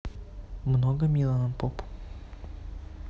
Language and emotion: Russian, neutral